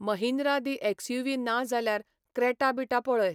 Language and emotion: Goan Konkani, neutral